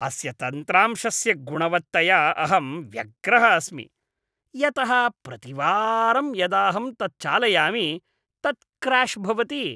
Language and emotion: Sanskrit, disgusted